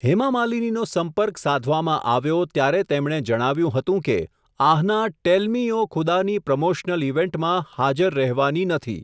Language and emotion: Gujarati, neutral